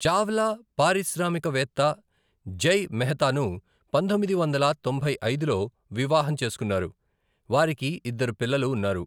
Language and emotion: Telugu, neutral